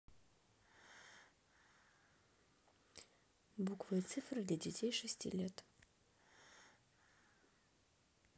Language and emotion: Russian, neutral